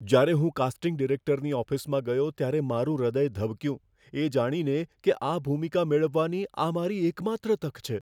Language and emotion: Gujarati, fearful